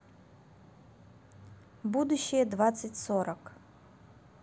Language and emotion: Russian, neutral